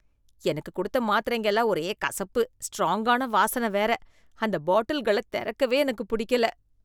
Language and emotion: Tamil, disgusted